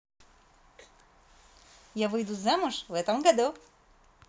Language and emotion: Russian, positive